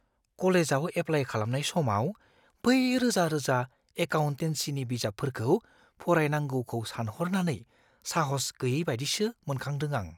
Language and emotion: Bodo, fearful